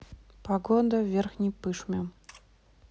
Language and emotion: Russian, neutral